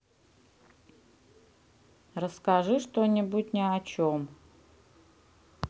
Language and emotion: Russian, neutral